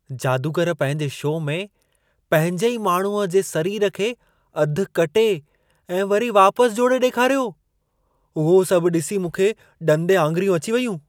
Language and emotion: Sindhi, surprised